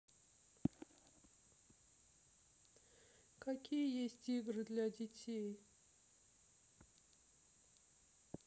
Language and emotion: Russian, sad